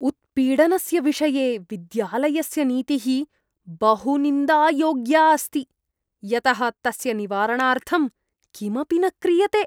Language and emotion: Sanskrit, disgusted